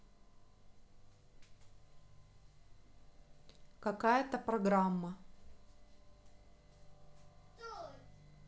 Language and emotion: Russian, neutral